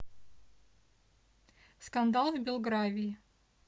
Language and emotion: Russian, neutral